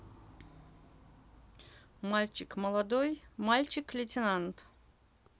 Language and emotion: Russian, neutral